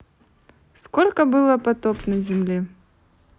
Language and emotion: Russian, neutral